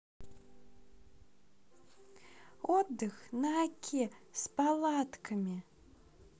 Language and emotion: Russian, positive